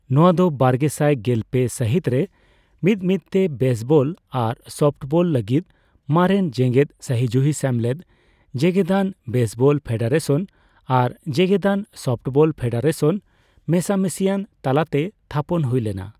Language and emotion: Santali, neutral